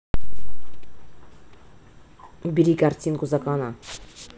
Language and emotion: Russian, angry